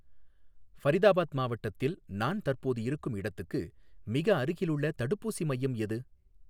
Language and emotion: Tamil, neutral